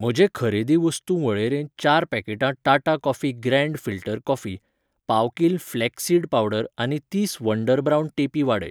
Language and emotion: Goan Konkani, neutral